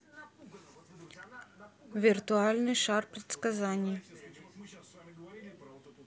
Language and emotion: Russian, neutral